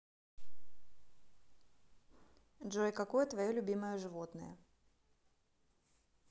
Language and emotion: Russian, neutral